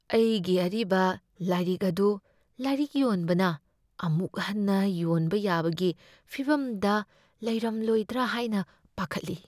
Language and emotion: Manipuri, fearful